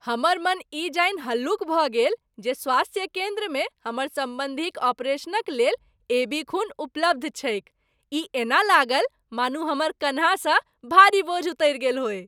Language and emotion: Maithili, happy